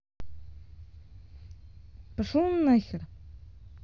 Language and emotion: Russian, angry